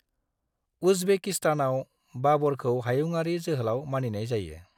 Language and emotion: Bodo, neutral